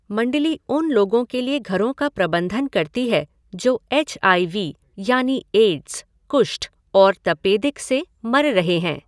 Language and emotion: Hindi, neutral